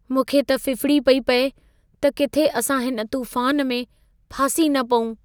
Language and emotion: Sindhi, fearful